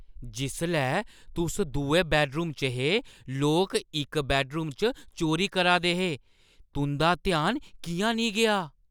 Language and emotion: Dogri, surprised